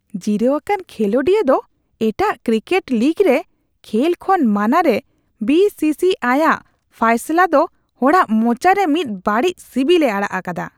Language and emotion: Santali, disgusted